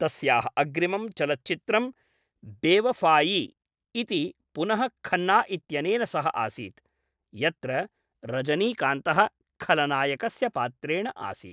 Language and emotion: Sanskrit, neutral